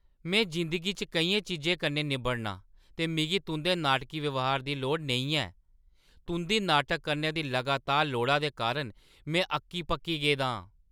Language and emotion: Dogri, angry